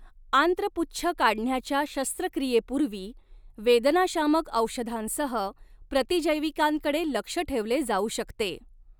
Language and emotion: Marathi, neutral